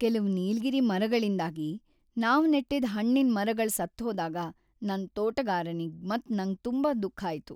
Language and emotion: Kannada, sad